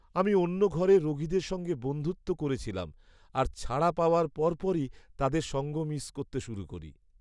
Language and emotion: Bengali, sad